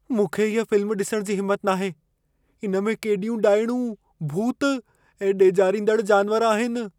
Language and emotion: Sindhi, fearful